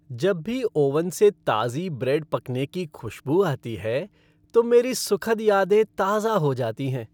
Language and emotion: Hindi, happy